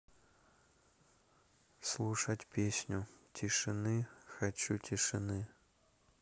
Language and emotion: Russian, neutral